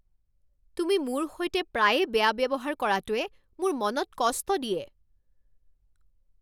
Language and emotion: Assamese, angry